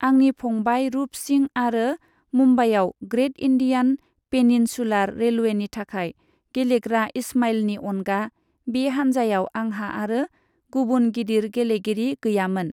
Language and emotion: Bodo, neutral